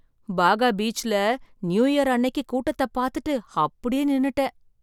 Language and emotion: Tamil, surprised